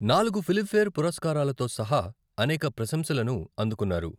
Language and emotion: Telugu, neutral